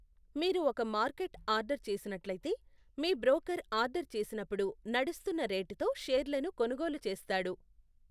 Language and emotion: Telugu, neutral